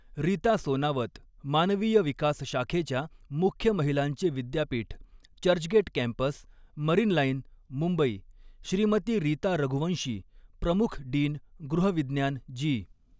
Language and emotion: Marathi, neutral